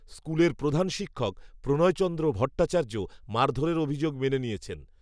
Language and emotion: Bengali, neutral